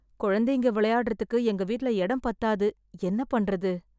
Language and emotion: Tamil, sad